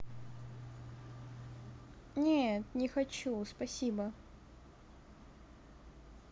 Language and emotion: Russian, neutral